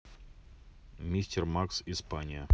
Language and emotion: Russian, neutral